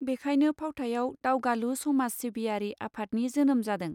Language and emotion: Bodo, neutral